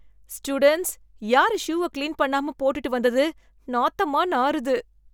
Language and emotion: Tamil, disgusted